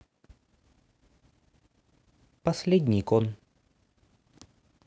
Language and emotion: Russian, sad